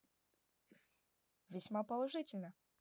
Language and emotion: Russian, positive